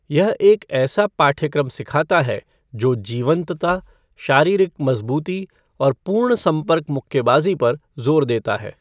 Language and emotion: Hindi, neutral